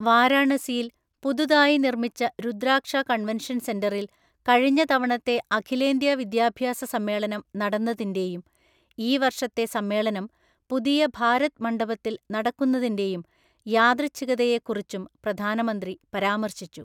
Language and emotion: Malayalam, neutral